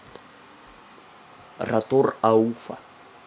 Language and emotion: Russian, neutral